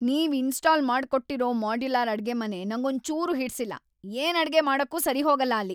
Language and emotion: Kannada, angry